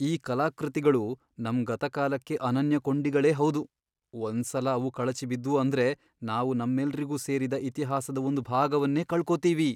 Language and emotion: Kannada, fearful